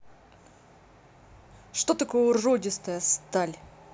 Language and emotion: Russian, angry